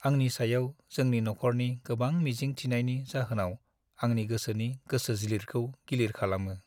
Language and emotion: Bodo, sad